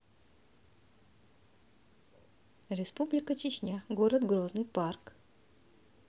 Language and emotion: Russian, neutral